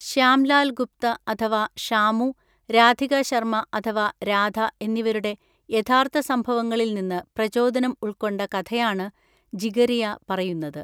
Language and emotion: Malayalam, neutral